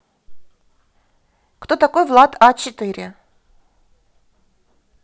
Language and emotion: Russian, positive